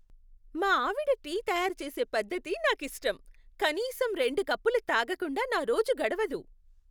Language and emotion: Telugu, happy